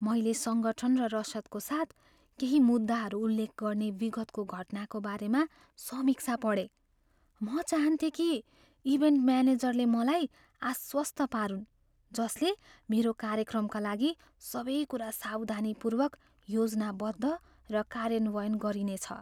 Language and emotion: Nepali, fearful